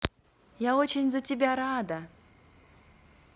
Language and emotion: Russian, positive